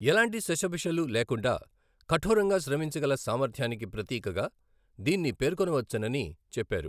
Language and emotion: Telugu, neutral